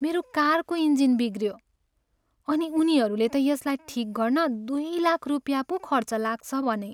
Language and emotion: Nepali, sad